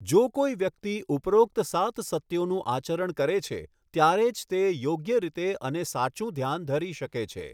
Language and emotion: Gujarati, neutral